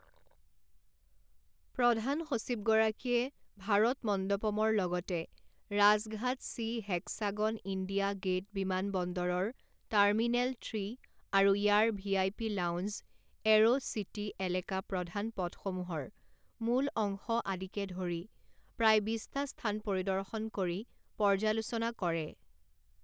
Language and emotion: Assamese, neutral